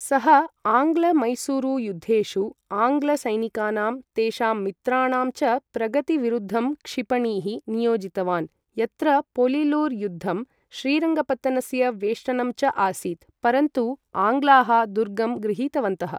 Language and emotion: Sanskrit, neutral